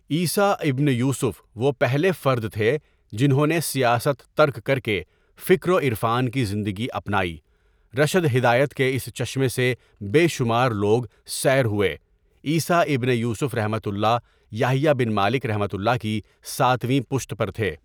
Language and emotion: Urdu, neutral